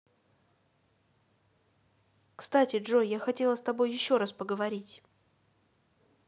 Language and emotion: Russian, neutral